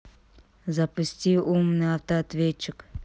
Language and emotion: Russian, neutral